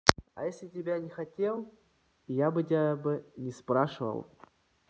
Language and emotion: Russian, neutral